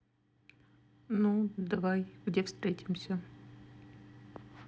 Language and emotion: Russian, neutral